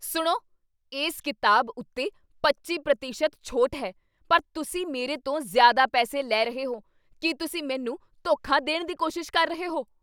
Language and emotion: Punjabi, angry